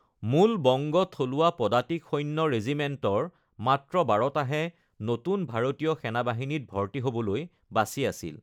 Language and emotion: Assamese, neutral